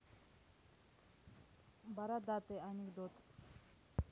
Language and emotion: Russian, neutral